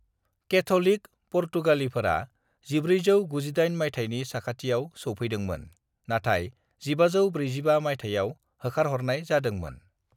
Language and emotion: Bodo, neutral